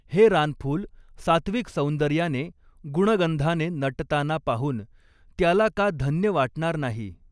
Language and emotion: Marathi, neutral